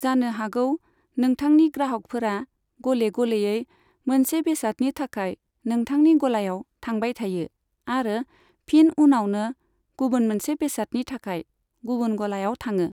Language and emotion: Bodo, neutral